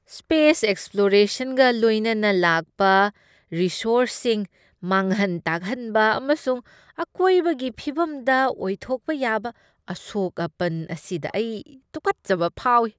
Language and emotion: Manipuri, disgusted